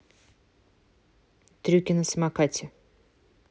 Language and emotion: Russian, neutral